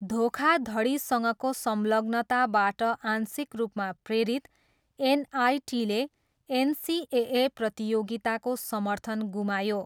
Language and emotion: Nepali, neutral